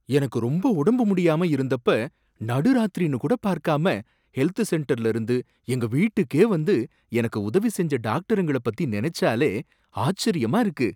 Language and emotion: Tamil, surprised